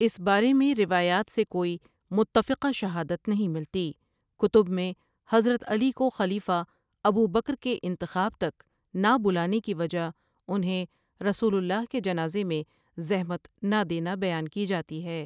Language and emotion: Urdu, neutral